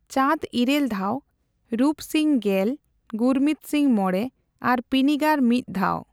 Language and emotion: Santali, neutral